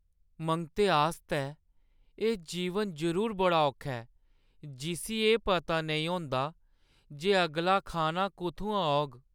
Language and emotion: Dogri, sad